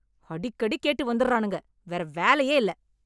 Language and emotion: Tamil, angry